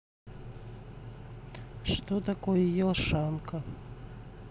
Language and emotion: Russian, neutral